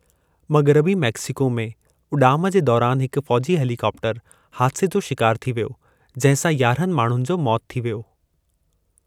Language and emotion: Sindhi, neutral